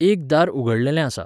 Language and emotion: Goan Konkani, neutral